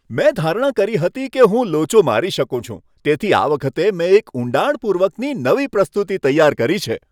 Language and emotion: Gujarati, happy